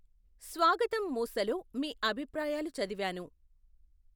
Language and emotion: Telugu, neutral